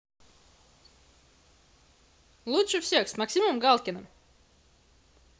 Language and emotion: Russian, positive